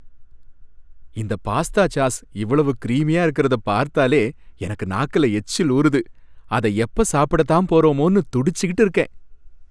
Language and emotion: Tamil, happy